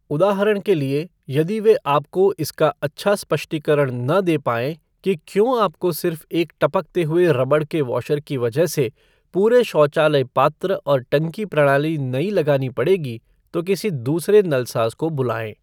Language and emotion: Hindi, neutral